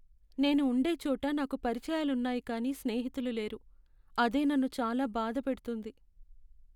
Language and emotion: Telugu, sad